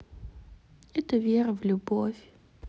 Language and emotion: Russian, sad